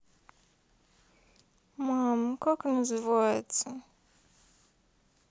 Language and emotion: Russian, sad